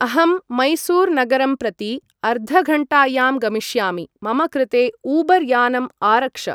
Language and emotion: Sanskrit, neutral